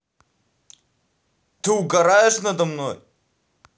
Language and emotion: Russian, angry